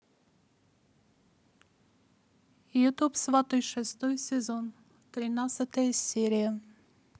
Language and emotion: Russian, neutral